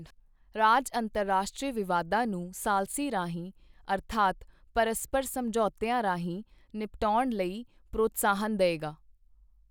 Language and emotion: Punjabi, neutral